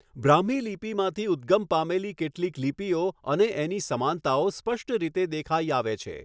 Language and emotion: Gujarati, neutral